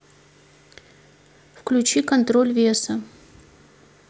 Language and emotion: Russian, neutral